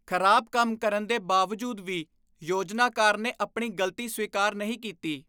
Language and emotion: Punjabi, disgusted